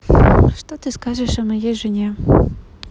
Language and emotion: Russian, neutral